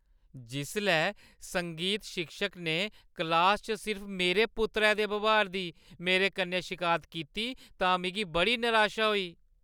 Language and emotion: Dogri, sad